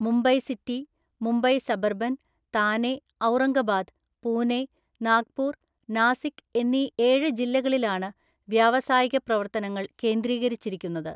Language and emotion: Malayalam, neutral